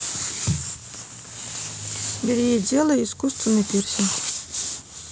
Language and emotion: Russian, neutral